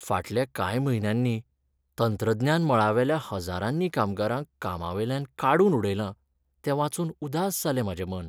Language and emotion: Goan Konkani, sad